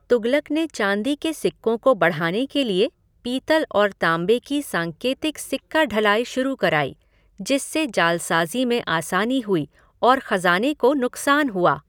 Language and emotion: Hindi, neutral